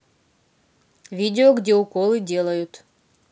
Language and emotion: Russian, neutral